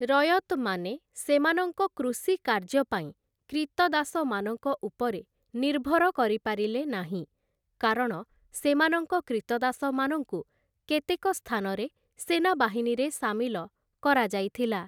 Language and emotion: Odia, neutral